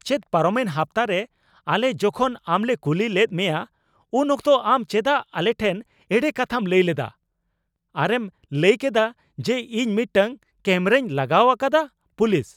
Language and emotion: Santali, angry